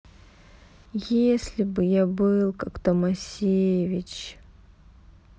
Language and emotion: Russian, sad